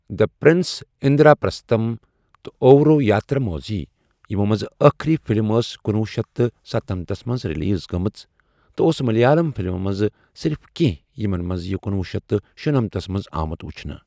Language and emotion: Kashmiri, neutral